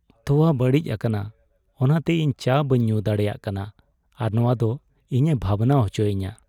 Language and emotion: Santali, sad